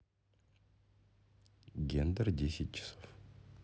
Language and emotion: Russian, neutral